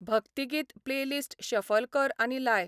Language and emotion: Goan Konkani, neutral